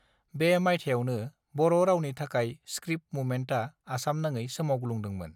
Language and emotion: Bodo, neutral